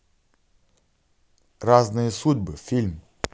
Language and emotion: Russian, neutral